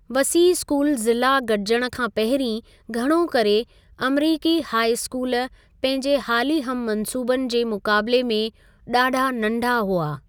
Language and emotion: Sindhi, neutral